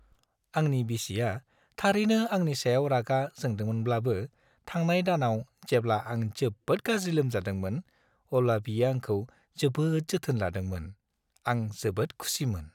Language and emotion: Bodo, happy